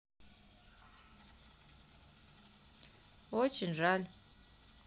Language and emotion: Russian, sad